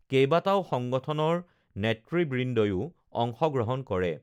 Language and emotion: Assamese, neutral